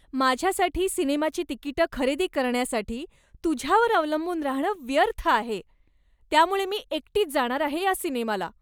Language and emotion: Marathi, disgusted